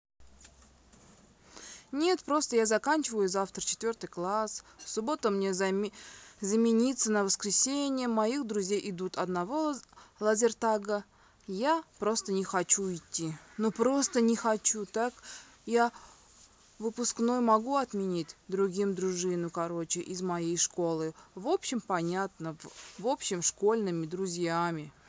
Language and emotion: Russian, sad